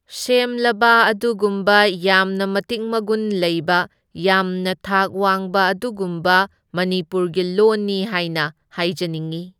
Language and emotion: Manipuri, neutral